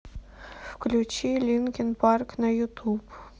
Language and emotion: Russian, sad